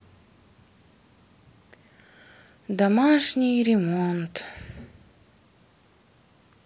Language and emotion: Russian, sad